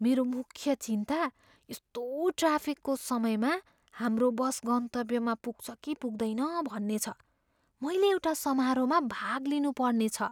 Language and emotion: Nepali, fearful